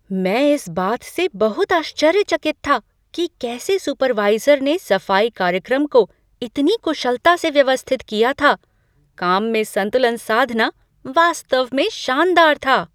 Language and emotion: Hindi, surprised